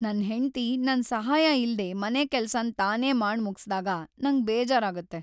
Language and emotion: Kannada, sad